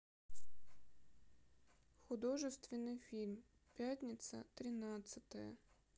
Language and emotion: Russian, sad